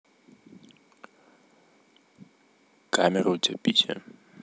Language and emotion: Russian, neutral